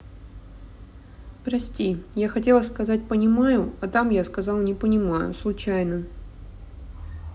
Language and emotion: Russian, sad